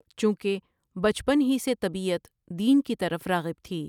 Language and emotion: Urdu, neutral